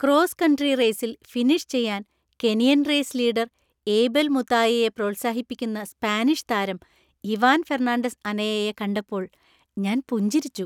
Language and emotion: Malayalam, happy